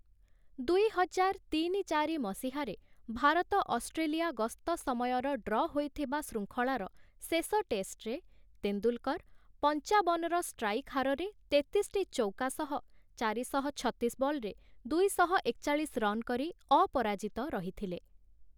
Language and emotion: Odia, neutral